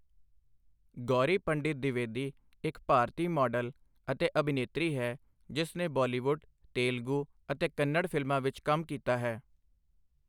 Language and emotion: Punjabi, neutral